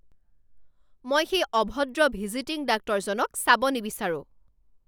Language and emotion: Assamese, angry